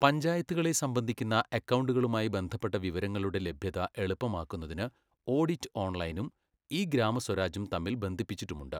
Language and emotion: Malayalam, neutral